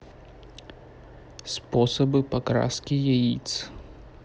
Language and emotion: Russian, neutral